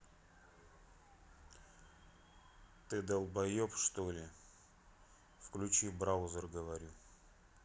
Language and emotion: Russian, neutral